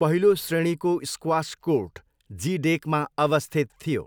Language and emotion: Nepali, neutral